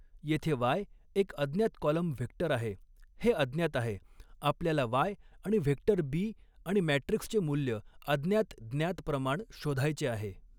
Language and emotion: Marathi, neutral